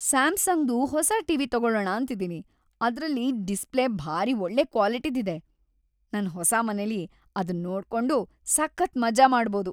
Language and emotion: Kannada, happy